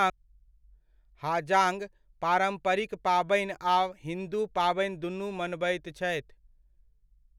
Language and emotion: Maithili, neutral